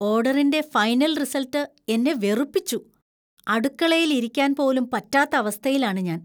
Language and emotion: Malayalam, disgusted